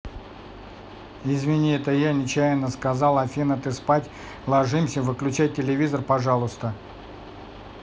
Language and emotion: Russian, neutral